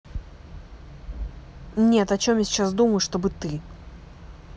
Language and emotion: Russian, angry